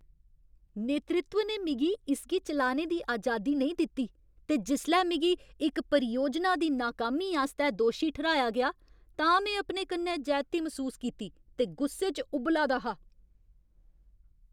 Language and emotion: Dogri, angry